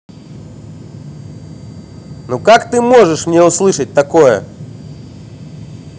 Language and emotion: Russian, angry